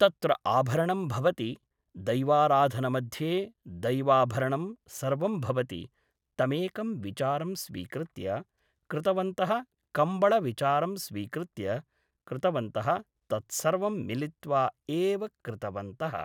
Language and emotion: Sanskrit, neutral